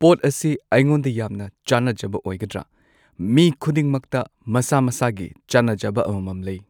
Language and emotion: Manipuri, neutral